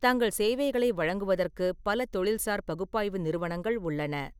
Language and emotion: Tamil, neutral